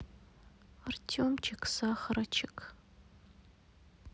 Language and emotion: Russian, sad